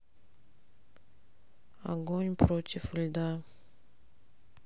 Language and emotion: Russian, sad